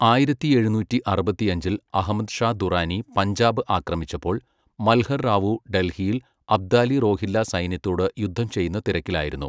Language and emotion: Malayalam, neutral